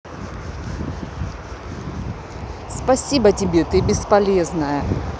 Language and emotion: Russian, angry